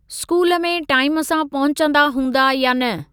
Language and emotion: Sindhi, neutral